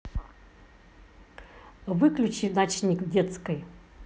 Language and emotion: Russian, angry